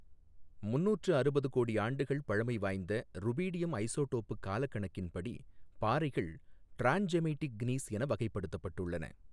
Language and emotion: Tamil, neutral